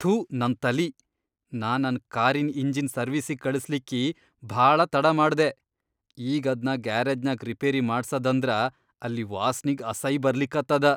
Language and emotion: Kannada, disgusted